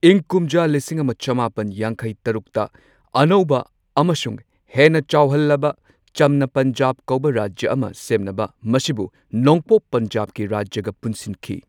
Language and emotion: Manipuri, neutral